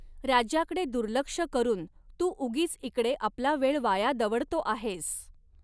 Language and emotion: Marathi, neutral